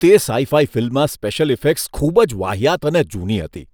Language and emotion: Gujarati, disgusted